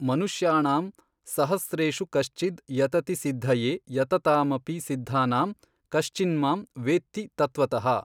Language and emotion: Kannada, neutral